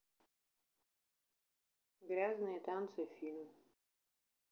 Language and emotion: Russian, neutral